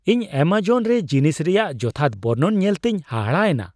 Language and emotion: Santali, surprised